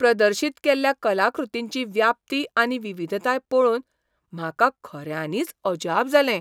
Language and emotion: Goan Konkani, surprised